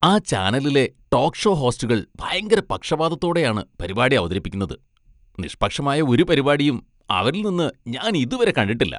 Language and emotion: Malayalam, disgusted